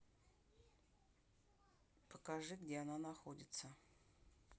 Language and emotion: Russian, neutral